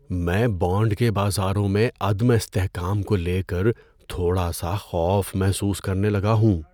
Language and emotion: Urdu, fearful